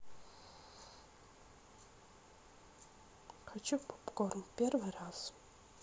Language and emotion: Russian, neutral